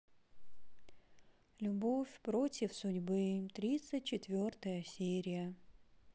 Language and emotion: Russian, sad